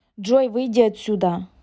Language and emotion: Russian, angry